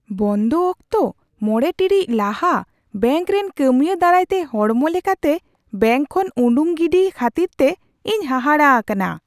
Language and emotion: Santali, surprised